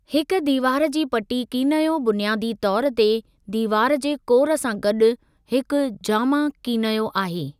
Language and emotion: Sindhi, neutral